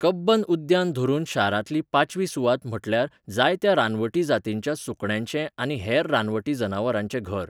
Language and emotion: Goan Konkani, neutral